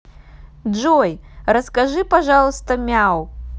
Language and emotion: Russian, positive